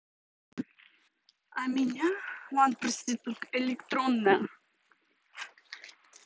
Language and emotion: Russian, neutral